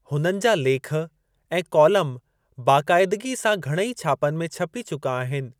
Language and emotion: Sindhi, neutral